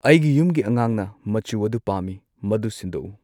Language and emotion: Manipuri, neutral